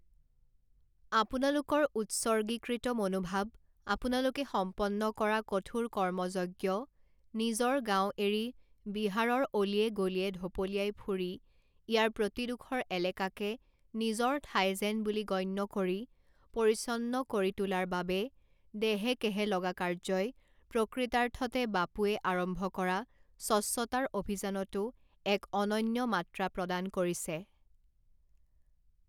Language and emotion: Assamese, neutral